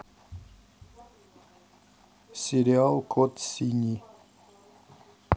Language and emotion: Russian, neutral